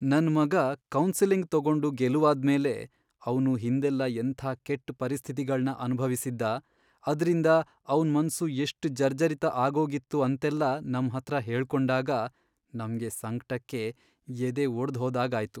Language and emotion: Kannada, sad